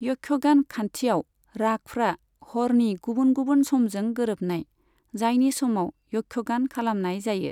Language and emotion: Bodo, neutral